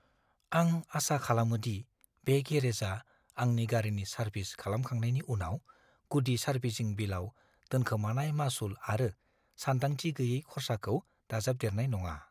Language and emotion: Bodo, fearful